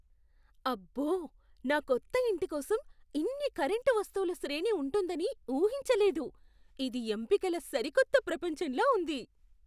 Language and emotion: Telugu, surprised